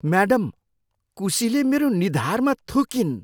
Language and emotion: Nepali, disgusted